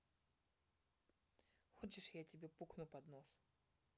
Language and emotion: Russian, neutral